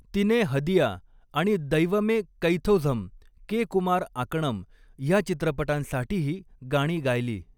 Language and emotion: Marathi, neutral